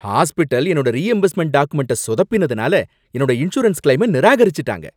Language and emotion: Tamil, angry